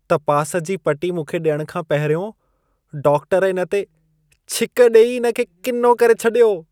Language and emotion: Sindhi, disgusted